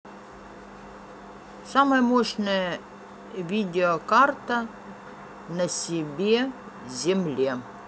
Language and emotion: Russian, neutral